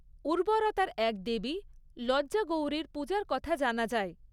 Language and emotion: Bengali, neutral